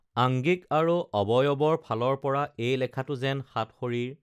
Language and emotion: Assamese, neutral